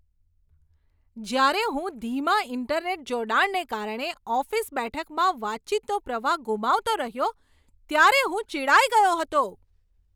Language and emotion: Gujarati, angry